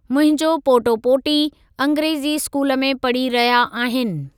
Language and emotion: Sindhi, neutral